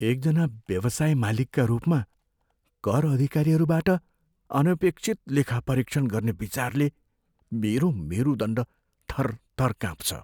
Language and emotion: Nepali, fearful